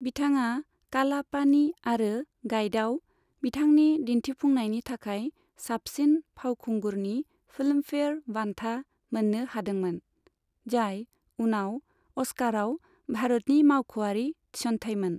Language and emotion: Bodo, neutral